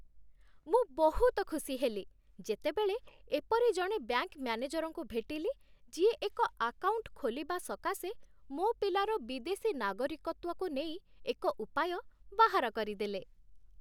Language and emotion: Odia, happy